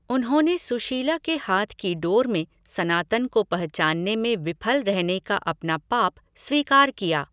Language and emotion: Hindi, neutral